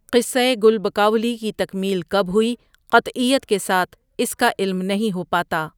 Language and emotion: Urdu, neutral